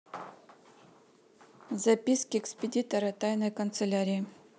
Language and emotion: Russian, neutral